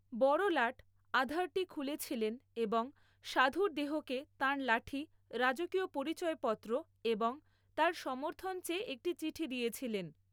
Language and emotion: Bengali, neutral